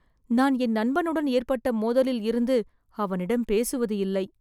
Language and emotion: Tamil, sad